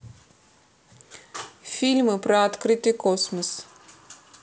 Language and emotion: Russian, neutral